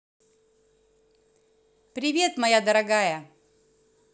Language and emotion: Russian, positive